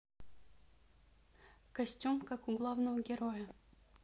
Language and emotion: Russian, neutral